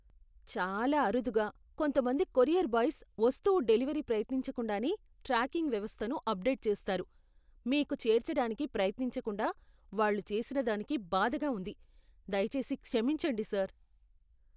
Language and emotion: Telugu, disgusted